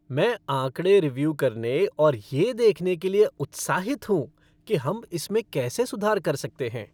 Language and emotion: Hindi, happy